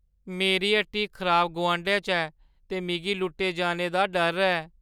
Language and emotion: Dogri, fearful